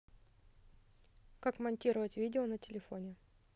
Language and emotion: Russian, neutral